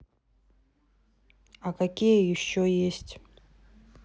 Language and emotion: Russian, neutral